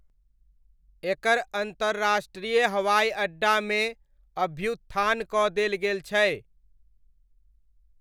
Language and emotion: Maithili, neutral